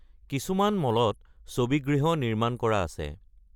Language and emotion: Assamese, neutral